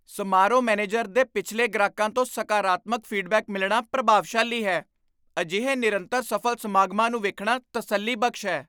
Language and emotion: Punjabi, surprised